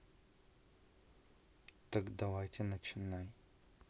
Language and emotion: Russian, neutral